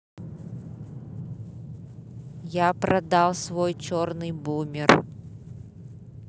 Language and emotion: Russian, neutral